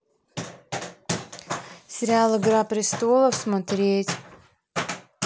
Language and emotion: Russian, neutral